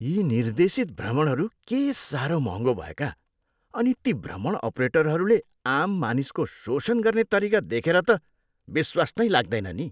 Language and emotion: Nepali, disgusted